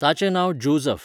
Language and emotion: Goan Konkani, neutral